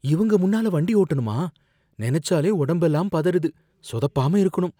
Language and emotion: Tamil, fearful